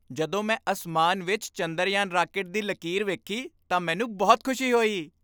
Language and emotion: Punjabi, happy